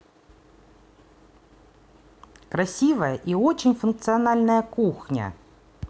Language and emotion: Russian, positive